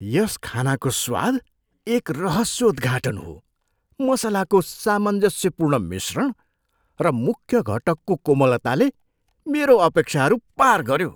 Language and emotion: Nepali, surprised